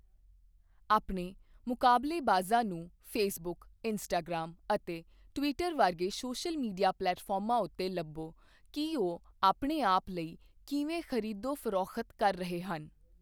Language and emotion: Punjabi, neutral